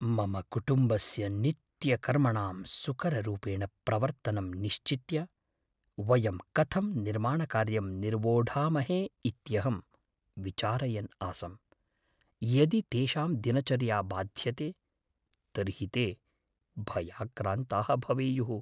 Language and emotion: Sanskrit, fearful